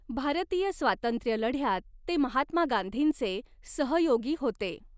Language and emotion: Marathi, neutral